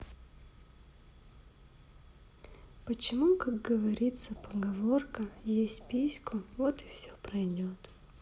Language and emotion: Russian, sad